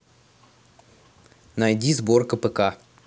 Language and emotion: Russian, neutral